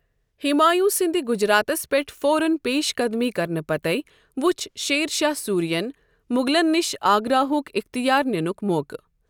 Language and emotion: Kashmiri, neutral